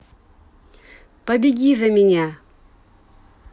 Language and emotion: Russian, neutral